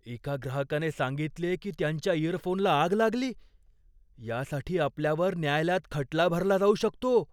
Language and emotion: Marathi, fearful